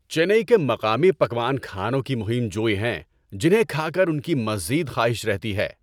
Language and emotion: Urdu, happy